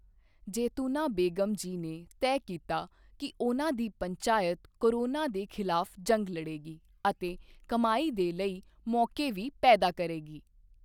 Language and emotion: Punjabi, neutral